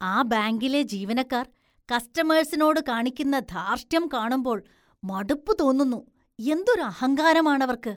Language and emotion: Malayalam, disgusted